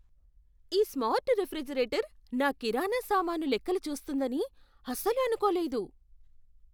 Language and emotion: Telugu, surprised